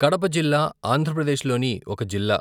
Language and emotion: Telugu, neutral